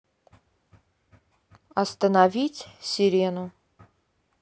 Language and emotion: Russian, neutral